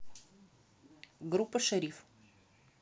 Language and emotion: Russian, neutral